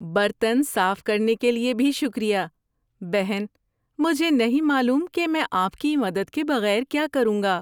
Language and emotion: Urdu, happy